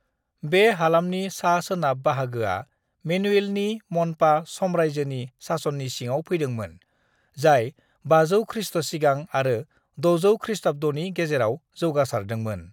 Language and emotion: Bodo, neutral